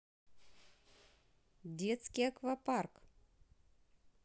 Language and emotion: Russian, neutral